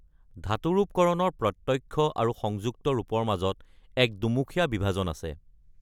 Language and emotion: Assamese, neutral